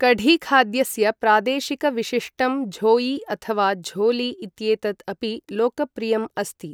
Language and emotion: Sanskrit, neutral